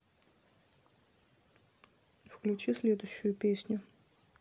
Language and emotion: Russian, neutral